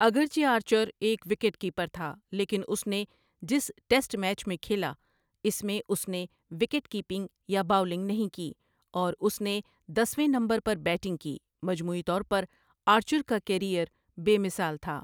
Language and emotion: Urdu, neutral